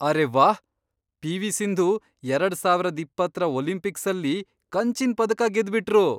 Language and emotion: Kannada, surprised